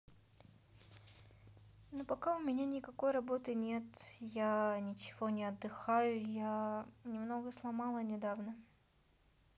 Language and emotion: Russian, sad